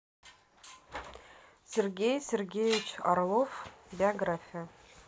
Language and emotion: Russian, neutral